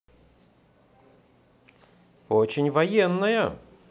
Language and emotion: Russian, positive